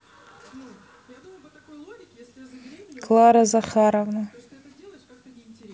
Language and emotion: Russian, neutral